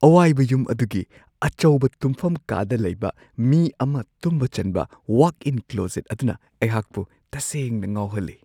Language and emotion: Manipuri, surprised